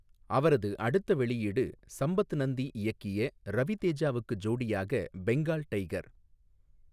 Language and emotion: Tamil, neutral